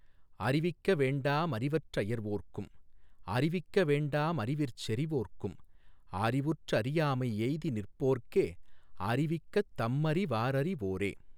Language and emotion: Tamil, neutral